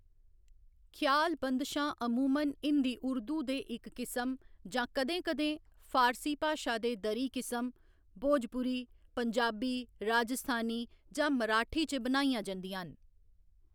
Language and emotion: Dogri, neutral